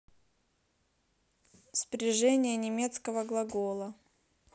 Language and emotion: Russian, neutral